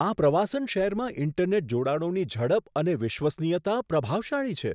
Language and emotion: Gujarati, surprised